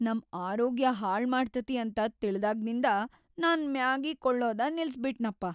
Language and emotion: Kannada, fearful